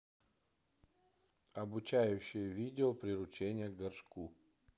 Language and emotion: Russian, neutral